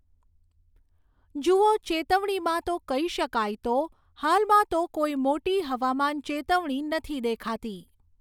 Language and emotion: Gujarati, neutral